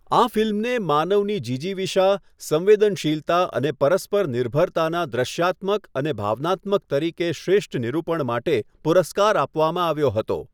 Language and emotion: Gujarati, neutral